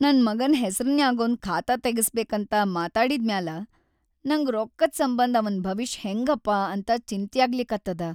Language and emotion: Kannada, sad